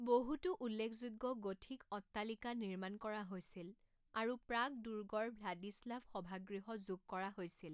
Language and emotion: Assamese, neutral